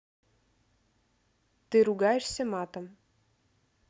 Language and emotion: Russian, neutral